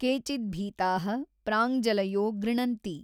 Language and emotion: Kannada, neutral